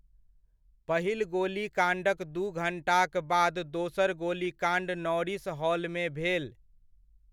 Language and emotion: Maithili, neutral